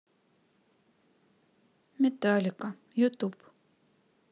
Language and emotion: Russian, sad